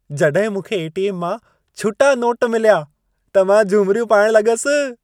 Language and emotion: Sindhi, happy